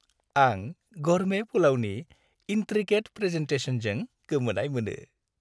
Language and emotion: Bodo, happy